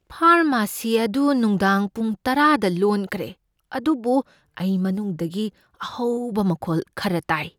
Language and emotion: Manipuri, fearful